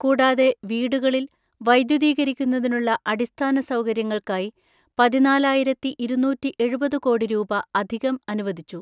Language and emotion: Malayalam, neutral